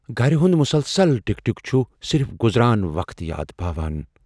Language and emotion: Kashmiri, fearful